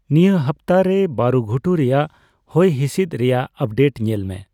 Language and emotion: Santali, neutral